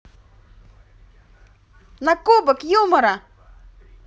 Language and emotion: Russian, positive